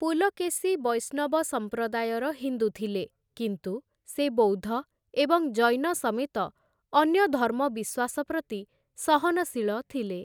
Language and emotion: Odia, neutral